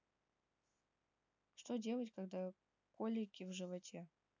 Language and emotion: Russian, neutral